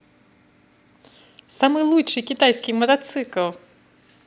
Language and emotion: Russian, positive